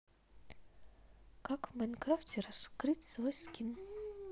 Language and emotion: Russian, neutral